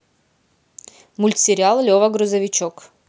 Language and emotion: Russian, positive